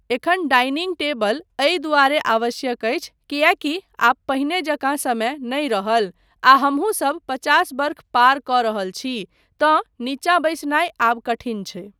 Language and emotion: Maithili, neutral